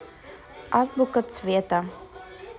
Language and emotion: Russian, neutral